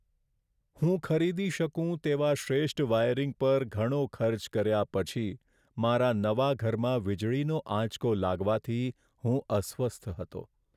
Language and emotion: Gujarati, sad